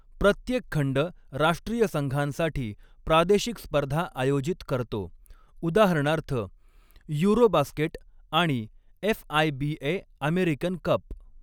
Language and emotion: Marathi, neutral